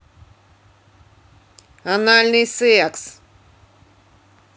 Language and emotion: Russian, angry